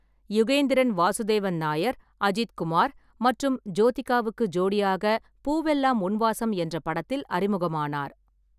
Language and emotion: Tamil, neutral